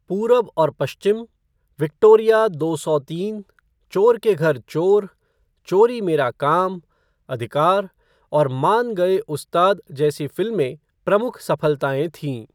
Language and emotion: Hindi, neutral